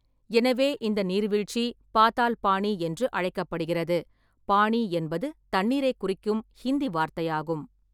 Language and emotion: Tamil, neutral